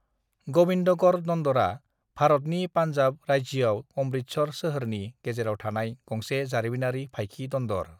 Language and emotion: Bodo, neutral